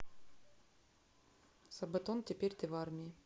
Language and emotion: Russian, neutral